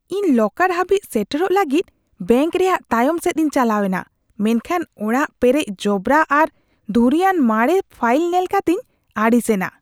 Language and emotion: Santali, disgusted